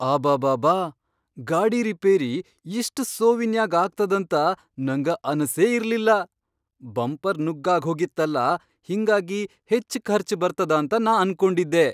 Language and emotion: Kannada, surprised